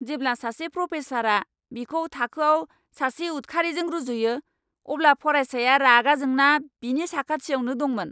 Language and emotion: Bodo, angry